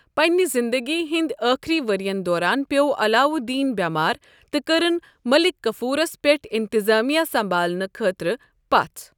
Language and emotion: Kashmiri, neutral